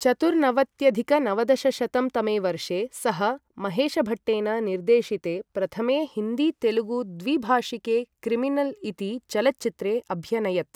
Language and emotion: Sanskrit, neutral